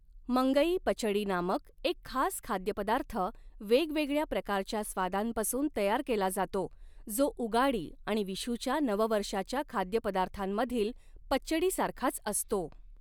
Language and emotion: Marathi, neutral